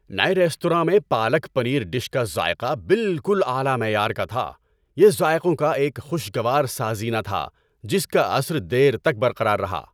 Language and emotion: Urdu, happy